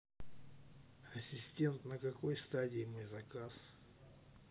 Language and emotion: Russian, neutral